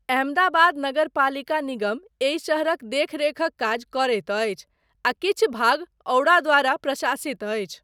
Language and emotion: Maithili, neutral